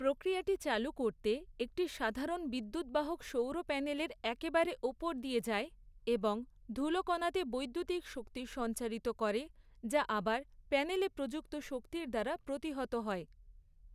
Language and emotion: Bengali, neutral